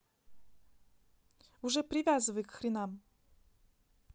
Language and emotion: Russian, neutral